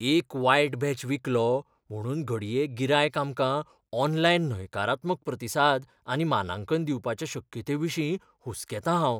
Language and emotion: Goan Konkani, fearful